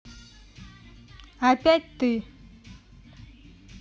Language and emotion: Russian, angry